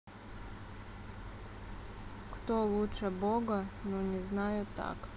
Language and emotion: Russian, sad